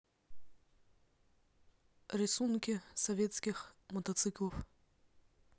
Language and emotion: Russian, neutral